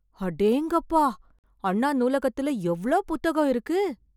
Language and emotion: Tamil, surprised